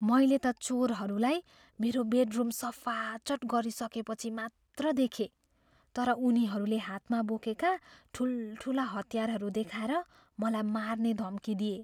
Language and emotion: Nepali, fearful